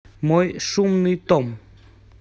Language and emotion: Russian, neutral